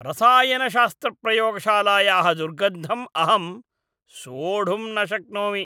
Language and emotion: Sanskrit, disgusted